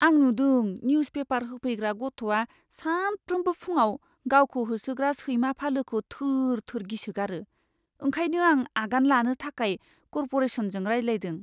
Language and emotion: Bodo, fearful